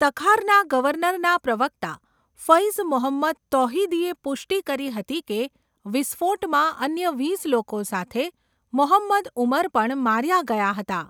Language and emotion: Gujarati, neutral